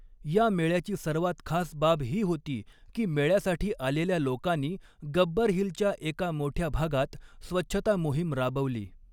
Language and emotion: Marathi, neutral